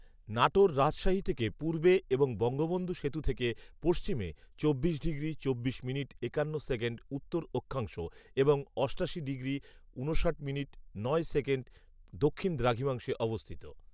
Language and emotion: Bengali, neutral